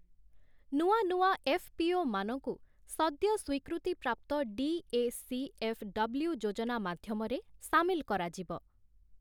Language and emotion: Odia, neutral